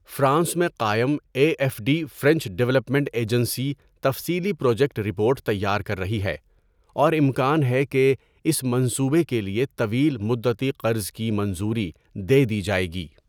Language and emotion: Urdu, neutral